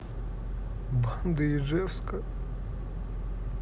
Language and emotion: Russian, sad